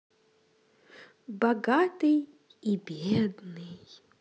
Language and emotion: Russian, positive